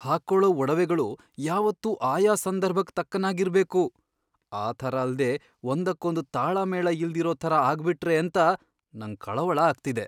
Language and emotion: Kannada, fearful